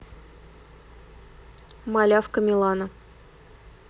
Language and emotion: Russian, neutral